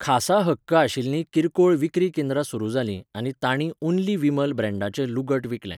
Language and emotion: Goan Konkani, neutral